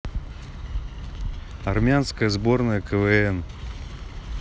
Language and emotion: Russian, neutral